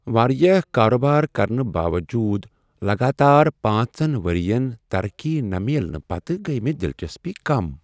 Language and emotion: Kashmiri, sad